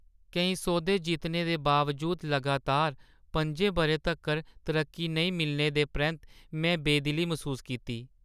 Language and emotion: Dogri, sad